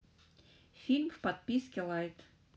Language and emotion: Russian, neutral